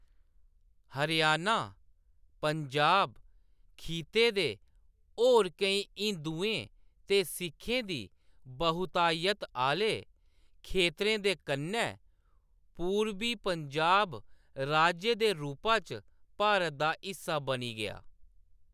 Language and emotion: Dogri, neutral